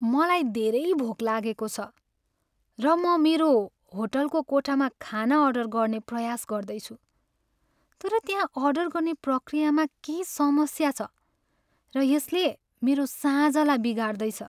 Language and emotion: Nepali, sad